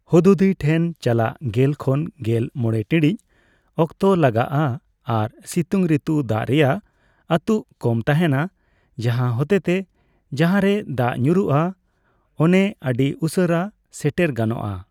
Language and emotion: Santali, neutral